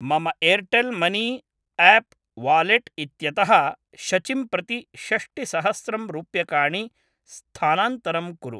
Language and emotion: Sanskrit, neutral